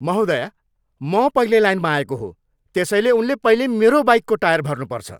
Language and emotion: Nepali, angry